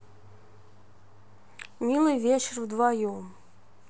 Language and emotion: Russian, neutral